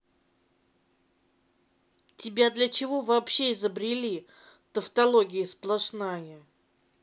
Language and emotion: Russian, angry